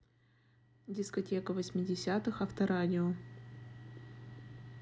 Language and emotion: Russian, neutral